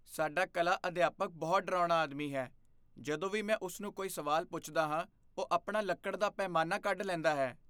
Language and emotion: Punjabi, fearful